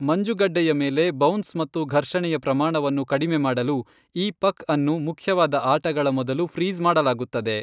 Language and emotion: Kannada, neutral